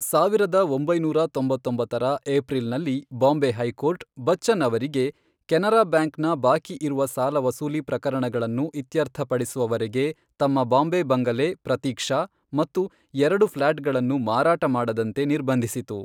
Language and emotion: Kannada, neutral